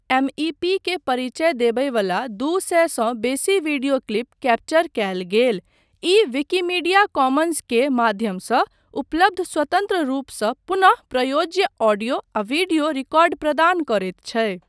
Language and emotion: Maithili, neutral